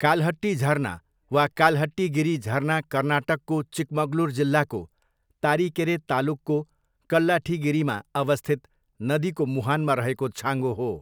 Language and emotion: Nepali, neutral